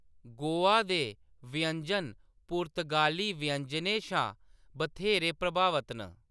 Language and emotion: Dogri, neutral